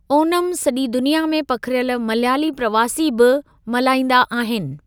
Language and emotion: Sindhi, neutral